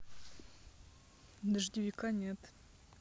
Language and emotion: Russian, neutral